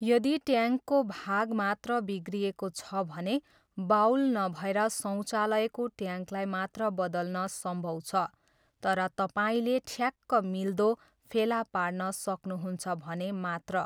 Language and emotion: Nepali, neutral